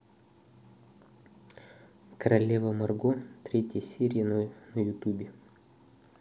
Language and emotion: Russian, neutral